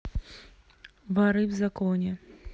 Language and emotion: Russian, neutral